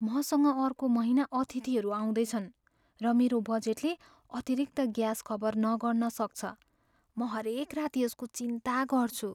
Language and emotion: Nepali, fearful